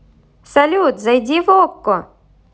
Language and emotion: Russian, positive